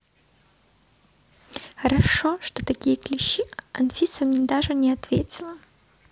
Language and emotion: Russian, neutral